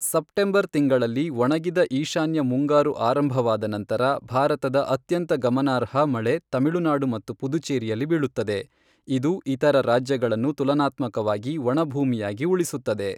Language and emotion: Kannada, neutral